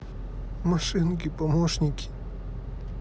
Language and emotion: Russian, sad